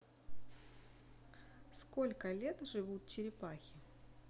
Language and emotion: Russian, neutral